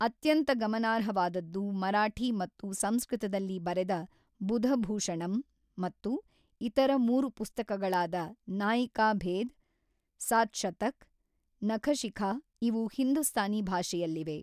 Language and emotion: Kannada, neutral